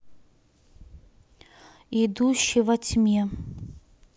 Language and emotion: Russian, neutral